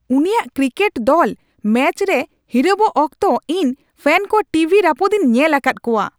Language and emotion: Santali, angry